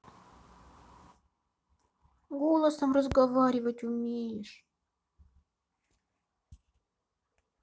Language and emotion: Russian, sad